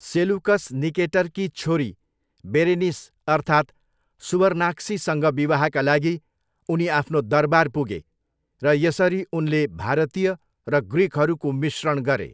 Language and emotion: Nepali, neutral